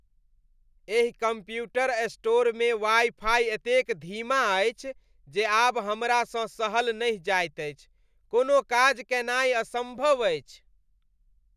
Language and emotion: Maithili, disgusted